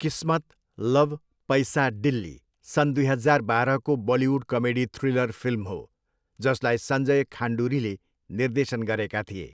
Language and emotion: Nepali, neutral